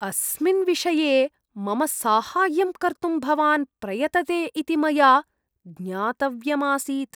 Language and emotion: Sanskrit, disgusted